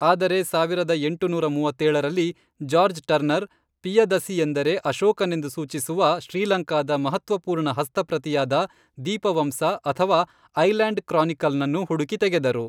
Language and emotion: Kannada, neutral